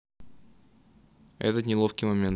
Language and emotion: Russian, neutral